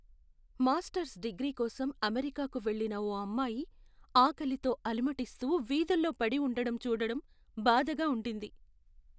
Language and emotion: Telugu, sad